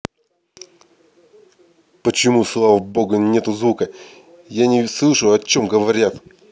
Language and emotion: Russian, angry